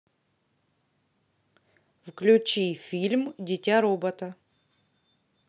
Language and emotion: Russian, neutral